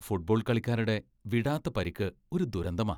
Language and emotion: Malayalam, disgusted